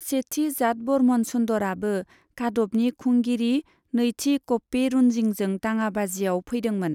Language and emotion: Bodo, neutral